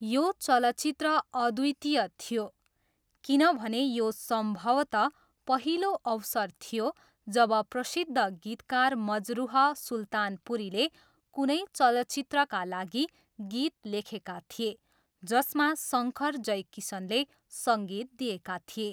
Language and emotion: Nepali, neutral